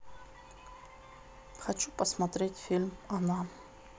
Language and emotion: Russian, neutral